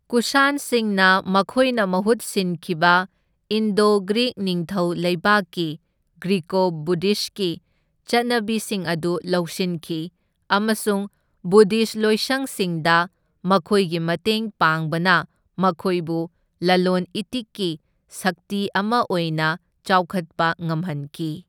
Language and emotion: Manipuri, neutral